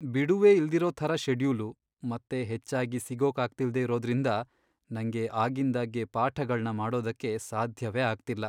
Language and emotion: Kannada, sad